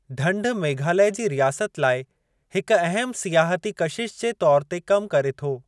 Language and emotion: Sindhi, neutral